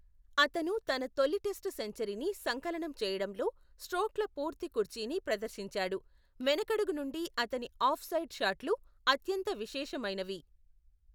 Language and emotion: Telugu, neutral